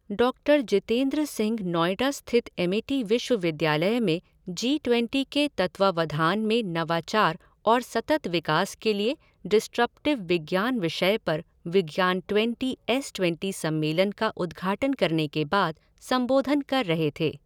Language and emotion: Hindi, neutral